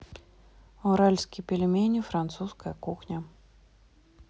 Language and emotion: Russian, neutral